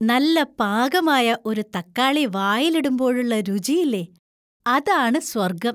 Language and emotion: Malayalam, happy